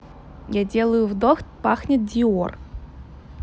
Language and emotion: Russian, neutral